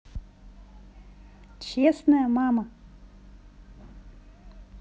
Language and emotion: Russian, positive